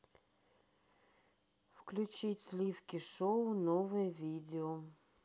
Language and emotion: Russian, neutral